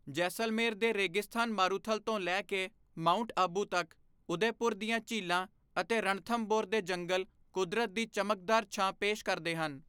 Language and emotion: Punjabi, neutral